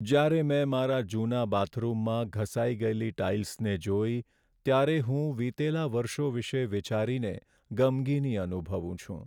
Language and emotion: Gujarati, sad